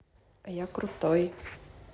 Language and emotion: Russian, positive